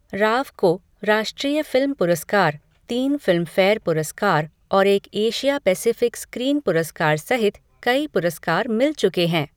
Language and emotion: Hindi, neutral